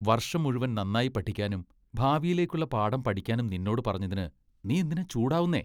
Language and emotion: Malayalam, disgusted